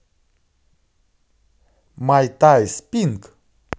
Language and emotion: Russian, positive